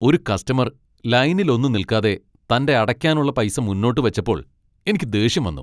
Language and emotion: Malayalam, angry